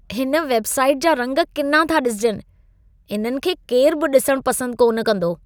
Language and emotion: Sindhi, disgusted